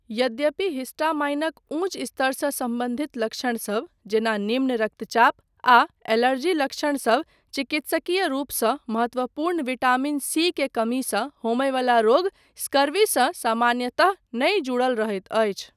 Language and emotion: Maithili, neutral